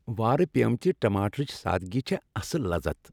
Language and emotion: Kashmiri, happy